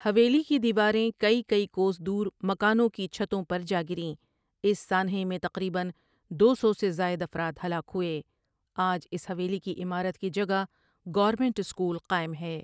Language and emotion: Urdu, neutral